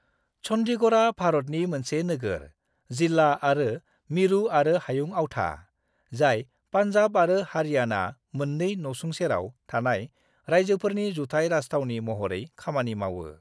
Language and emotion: Bodo, neutral